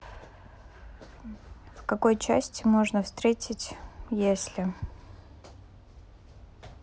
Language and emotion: Russian, neutral